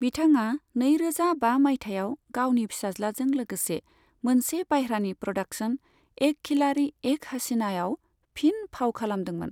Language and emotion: Bodo, neutral